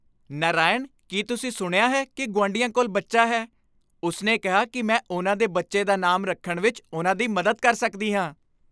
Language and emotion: Punjabi, happy